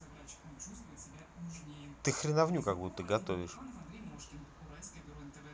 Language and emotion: Russian, angry